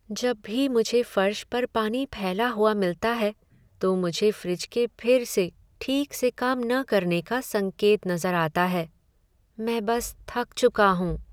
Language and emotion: Hindi, sad